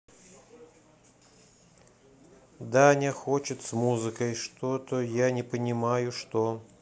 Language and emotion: Russian, neutral